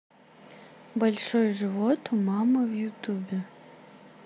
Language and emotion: Russian, neutral